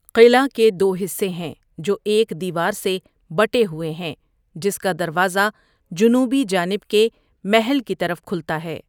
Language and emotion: Urdu, neutral